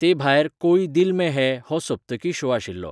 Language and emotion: Goan Konkani, neutral